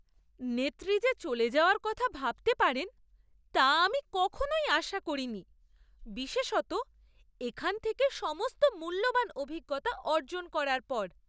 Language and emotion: Bengali, surprised